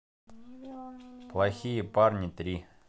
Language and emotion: Russian, neutral